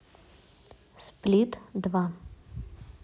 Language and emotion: Russian, neutral